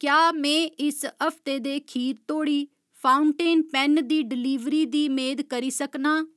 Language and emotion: Dogri, neutral